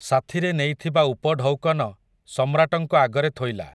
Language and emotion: Odia, neutral